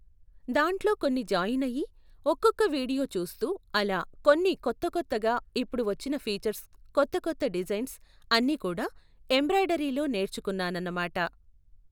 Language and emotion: Telugu, neutral